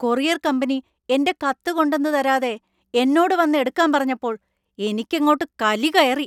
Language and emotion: Malayalam, angry